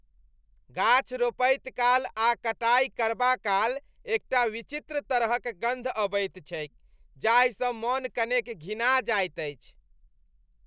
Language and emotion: Maithili, disgusted